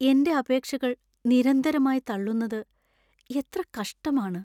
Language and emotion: Malayalam, sad